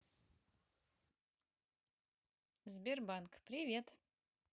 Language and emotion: Russian, neutral